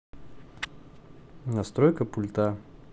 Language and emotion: Russian, neutral